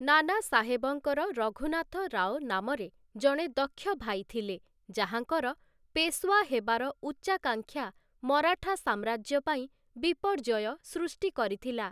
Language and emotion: Odia, neutral